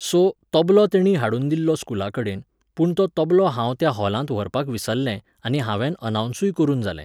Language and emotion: Goan Konkani, neutral